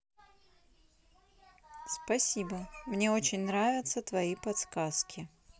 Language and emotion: Russian, neutral